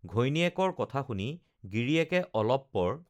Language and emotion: Assamese, neutral